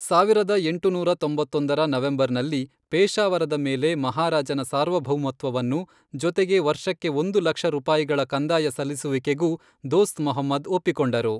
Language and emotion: Kannada, neutral